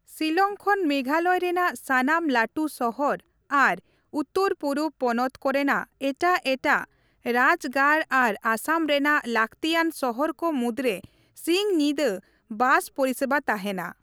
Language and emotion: Santali, neutral